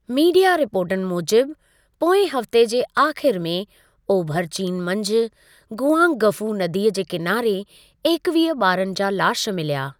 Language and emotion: Sindhi, neutral